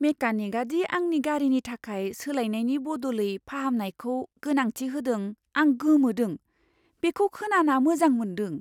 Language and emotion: Bodo, surprised